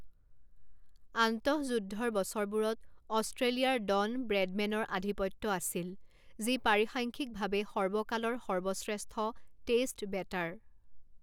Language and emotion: Assamese, neutral